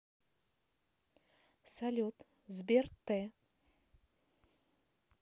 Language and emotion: Russian, neutral